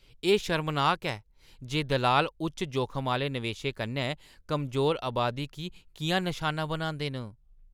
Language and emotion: Dogri, disgusted